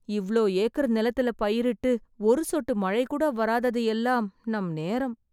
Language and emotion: Tamil, sad